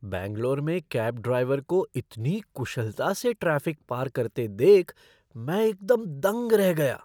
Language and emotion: Hindi, surprised